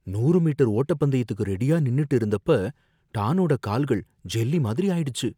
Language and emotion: Tamil, fearful